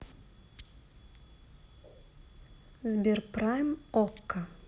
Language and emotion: Russian, neutral